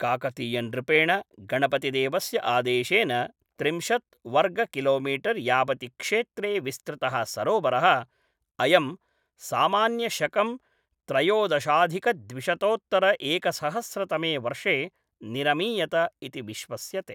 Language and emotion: Sanskrit, neutral